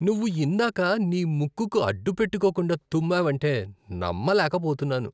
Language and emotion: Telugu, disgusted